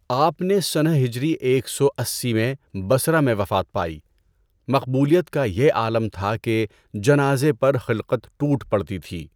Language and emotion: Urdu, neutral